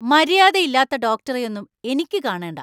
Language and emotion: Malayalam, angry